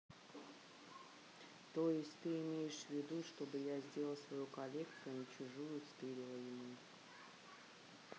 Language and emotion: Russian, neutral